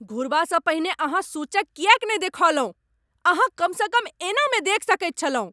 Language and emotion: Maithili, angry